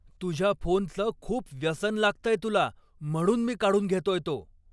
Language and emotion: Marathi, angry